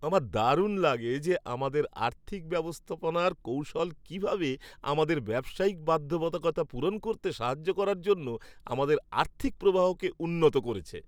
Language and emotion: Bengali, happy